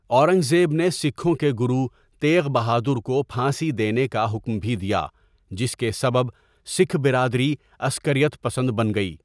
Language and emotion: Urdu, neutral